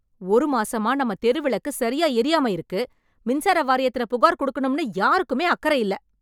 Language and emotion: Tamil, angry